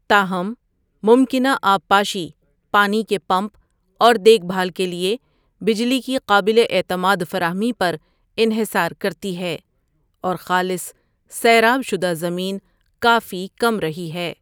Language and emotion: Urdu, neutral